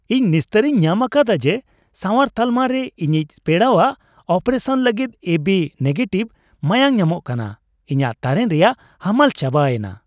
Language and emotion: Santali, happy